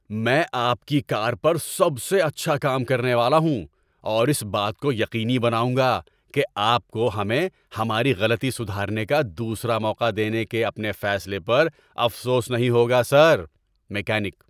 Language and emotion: Urdu, happy